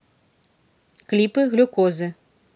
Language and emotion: Russian, neutral